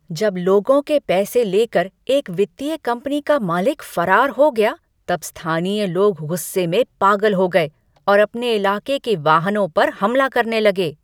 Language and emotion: Hindi, angry